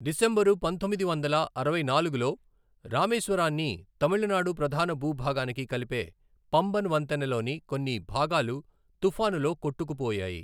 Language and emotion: Telugu, neutral